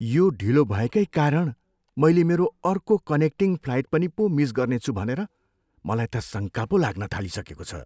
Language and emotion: Nepali, fearful